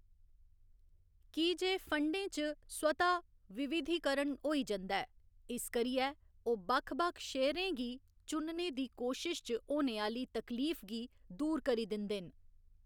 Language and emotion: Dogri, neutral